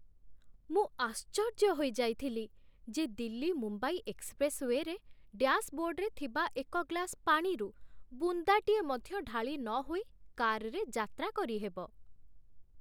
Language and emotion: Odia, surprised